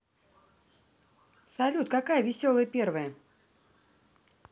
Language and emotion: Russian, positive